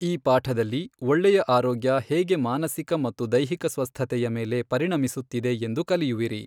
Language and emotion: Kannada, neutral